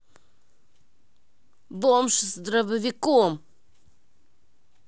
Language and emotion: Russian, angry